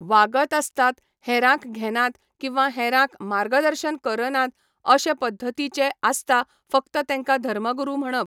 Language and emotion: Goan Konkani, neutral